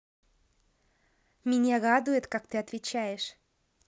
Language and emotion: Russian, positive